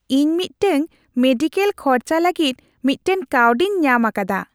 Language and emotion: Santali, happy